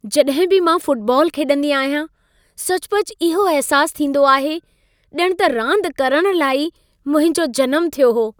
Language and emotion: Sindhi, happy